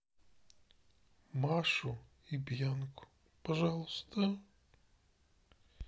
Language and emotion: Russian, sad